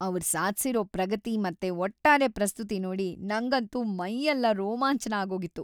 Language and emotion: Kannada, happy